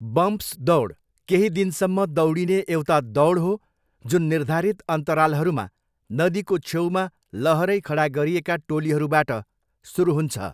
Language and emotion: Nepali, neutral